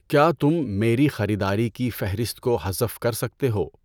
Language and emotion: Urdu, neutral